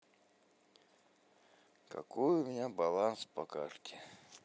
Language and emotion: Russian, sad